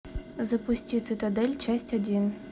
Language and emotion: Russian, neutral